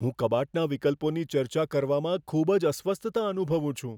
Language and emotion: Gujarati, fearful